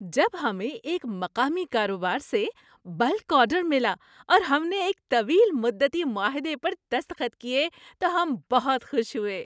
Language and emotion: Urdu, happy